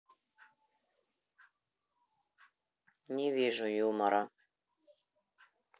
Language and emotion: Russian, neutral